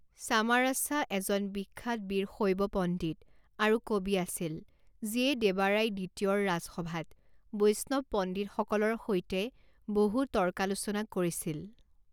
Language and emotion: Assamese, neutral